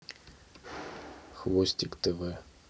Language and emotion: Russian, neutral